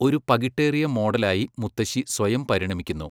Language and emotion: Malayalam, neutral